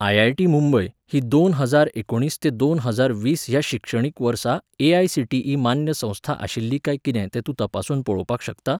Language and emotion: Goan Konkani, neutral